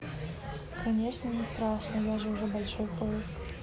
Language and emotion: Russian, neutral